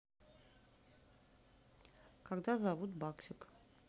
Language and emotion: Russian, neutral